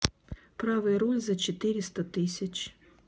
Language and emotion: Russian, neutral